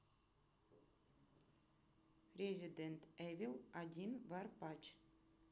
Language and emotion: Russian, neutral